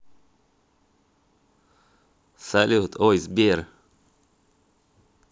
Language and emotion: Russian, neutral